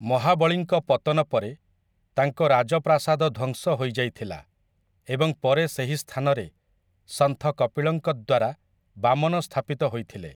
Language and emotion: Odia, neutral